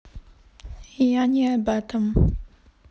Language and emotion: Russian, neutral